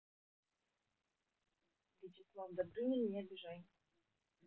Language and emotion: Russian, neutral